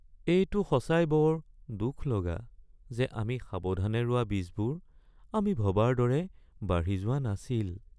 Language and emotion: Assamese, sad